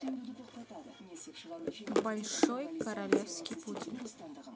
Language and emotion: Russian, neutral